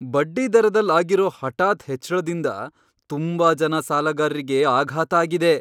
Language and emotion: Kannada, surprised